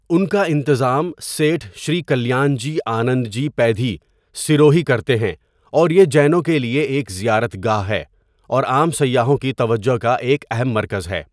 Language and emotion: Urdu, neutral